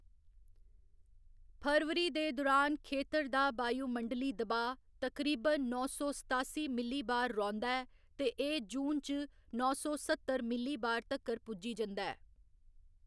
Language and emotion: Dogri, neutral